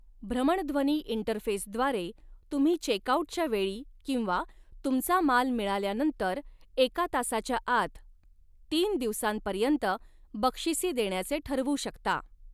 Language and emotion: Marathi, neutral